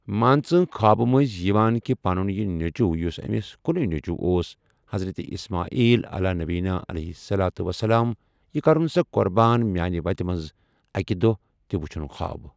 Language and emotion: Kashmiri, neutral